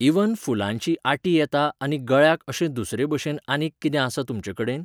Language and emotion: Goan Konkani, neutral